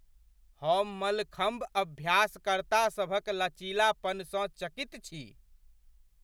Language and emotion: Maithili, surprised